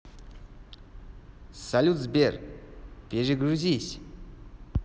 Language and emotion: Russian, positive